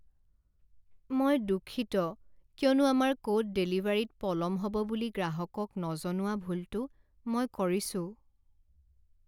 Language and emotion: Assamese, sad